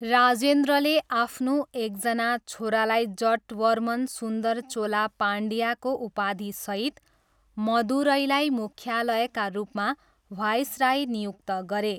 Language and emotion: Nepali, neutral